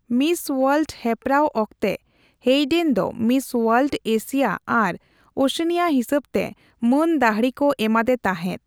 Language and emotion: Santali, neutral